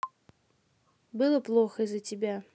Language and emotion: Russian, neutral